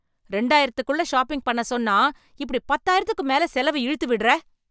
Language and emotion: Tamil, angry